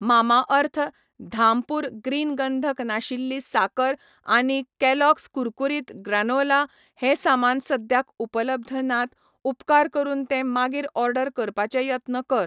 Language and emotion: Goan Konkani, neutral